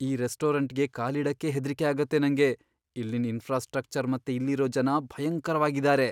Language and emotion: Kannada, fearful